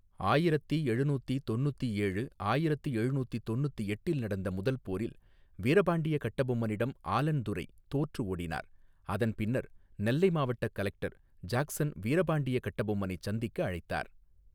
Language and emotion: Tamil, neutral